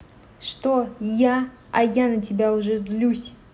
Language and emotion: Russian, angry